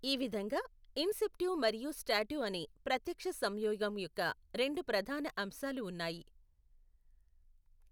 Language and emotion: Telugu, neutral